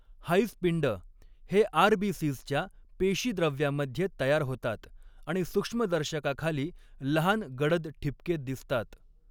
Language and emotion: Marathi, neutral